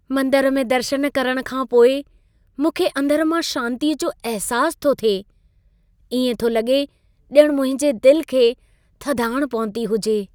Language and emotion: Sindhi, happy